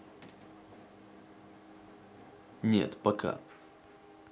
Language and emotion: Russian, neutral